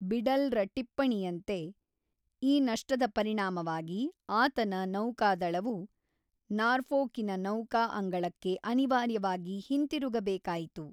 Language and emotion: Kannada, neutral